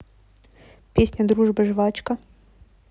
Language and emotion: Russian, neutral